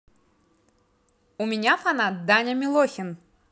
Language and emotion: Russian, positive